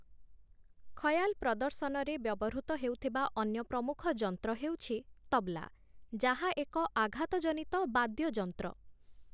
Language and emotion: Odia, neutral